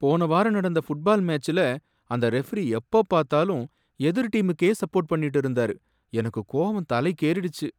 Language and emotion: Tamil, angry